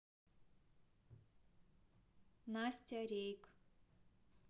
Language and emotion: Russian, neutral